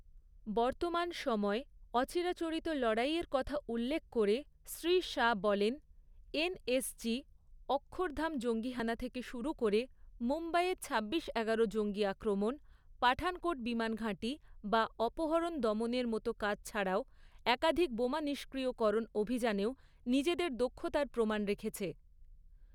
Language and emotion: Bengali, neutral